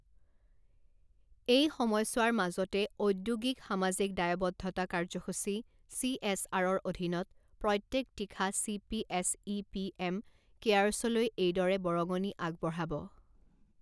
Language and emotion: Assamese, neutral